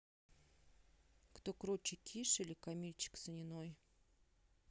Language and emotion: Russian, neutral